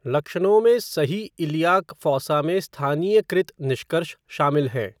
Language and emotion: Hindi, neutral